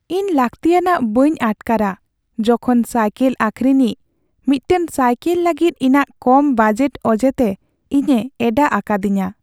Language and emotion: Santali, sad